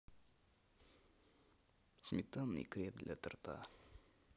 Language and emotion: Russian, neutral